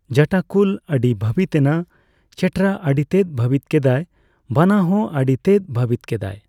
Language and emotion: Santali, neutral